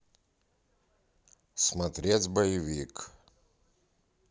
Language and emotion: Russian, neutral